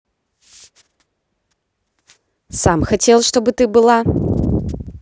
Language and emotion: Russian, neutral